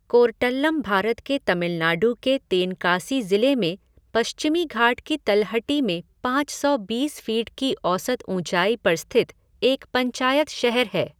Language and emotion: Hindi, neutral